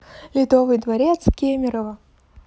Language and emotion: Russian, neutral